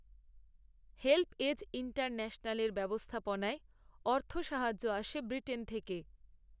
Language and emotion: Bengali, neutral